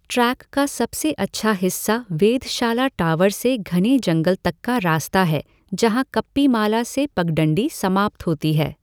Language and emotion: Hindi, neutral